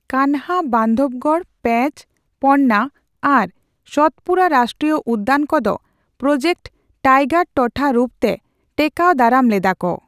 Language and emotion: Santali, neutral